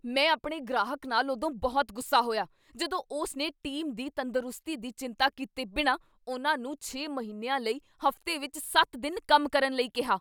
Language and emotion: Punjabi, angry